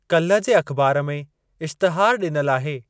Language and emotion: Sindhi, neutral